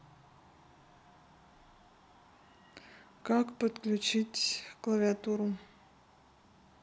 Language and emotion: Russian, neutral